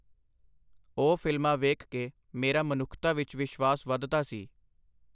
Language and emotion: Punjabi, neutral